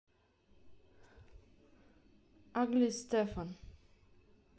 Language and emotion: Russian, neutral